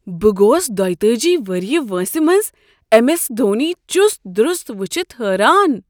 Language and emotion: Kashmiri, surprised